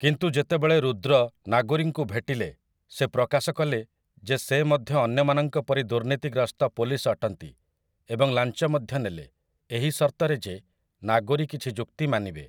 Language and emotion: Odia, neutral